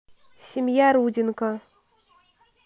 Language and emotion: Russian, neutral